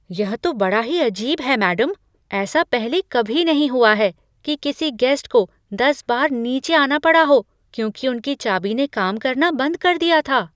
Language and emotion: Hindi, surprised